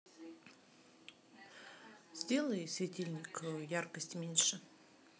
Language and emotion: Russian, neutral